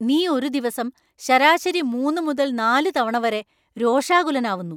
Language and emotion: Malayalam, angry